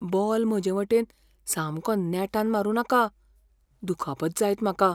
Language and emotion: Goan Konkani, fearful